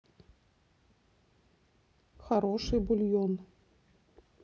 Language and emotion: Russian, neutral